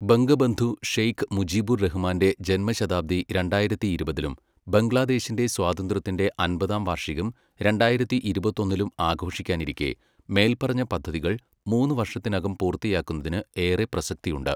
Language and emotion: Malayalam, neutral